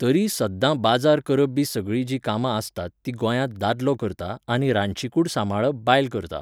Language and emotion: Goan Konkani, neutral